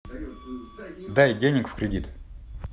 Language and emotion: Russian, neutral